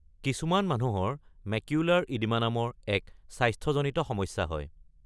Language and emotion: Assamese, neutral